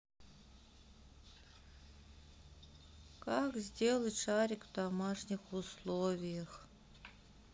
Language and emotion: Russian, sad